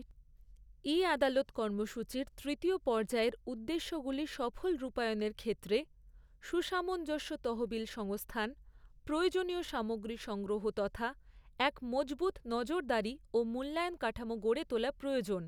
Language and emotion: Bengali, neutral